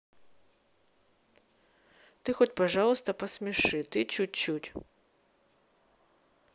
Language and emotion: Russian, neutral